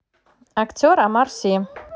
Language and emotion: Russian, neutral